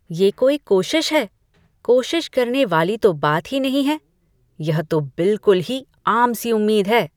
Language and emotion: Hindi, disgusted